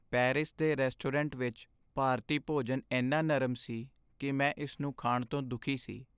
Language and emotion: Punjabi, sad